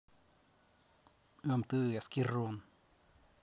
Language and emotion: Russian, angry